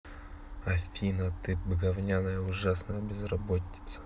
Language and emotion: Russian, neutral